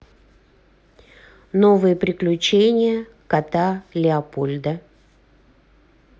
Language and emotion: Russian, neutral